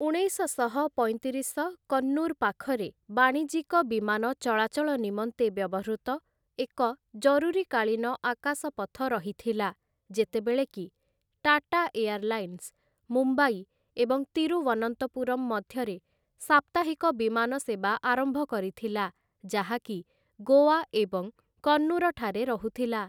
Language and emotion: Odia, neutral